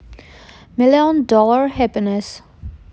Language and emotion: Russian, neutral